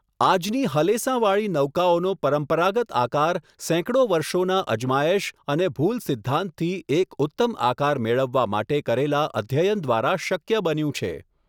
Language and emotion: Gujarati, neutral